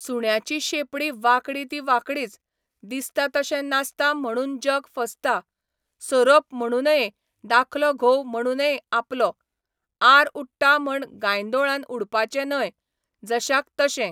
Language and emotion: Goan Konkani, neutral